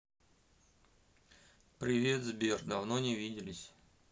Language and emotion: Russian, neutral